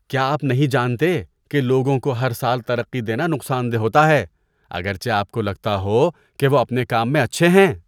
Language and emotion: Urdu, disgusted